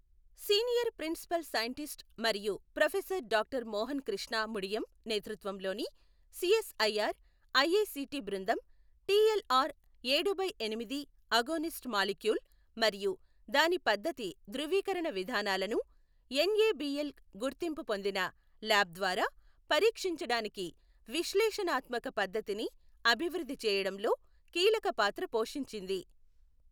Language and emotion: Telugu, neutral